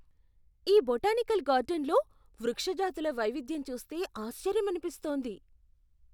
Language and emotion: Telugu, surprised